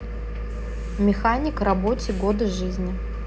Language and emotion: Russian, neutral